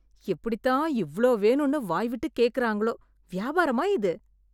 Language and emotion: Tamil, disgusted